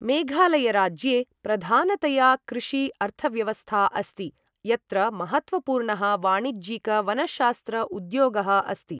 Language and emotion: Sanskrit, neutral